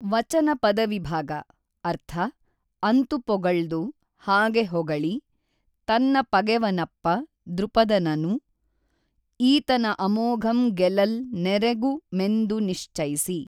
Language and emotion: Kannada, neutral